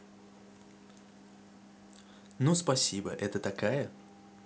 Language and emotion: Russian, neutral